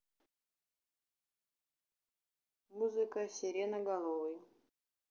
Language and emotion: Russian, neutral